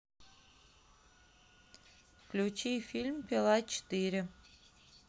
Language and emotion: Russian, neutral